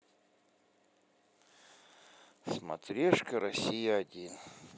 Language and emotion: Russian, sad